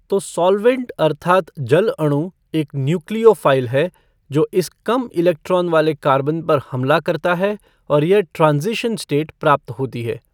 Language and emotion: Hindi, neutral